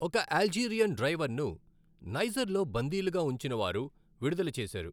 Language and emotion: Telugu, neutral